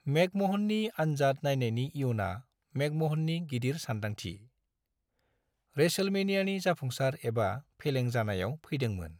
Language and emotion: Bodo, neutral